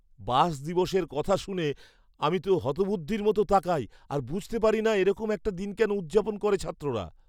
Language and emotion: Bengali, surprised